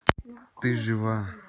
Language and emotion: Russian, neutral